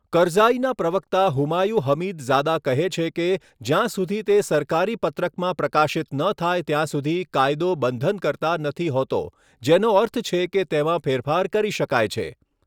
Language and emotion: Gujarati, neutral